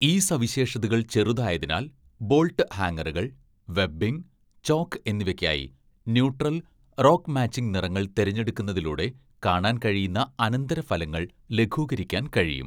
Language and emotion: Malayalam, neutral